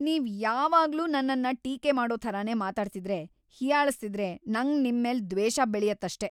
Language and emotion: Kannada, angry